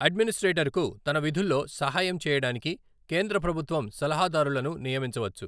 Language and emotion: Telugu, neutral